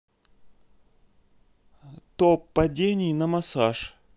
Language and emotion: Russian, neutral